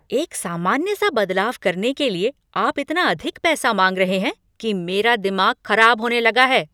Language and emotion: Hindi, angry